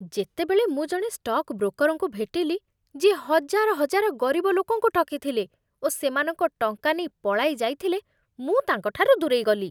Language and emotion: Odia, disgusted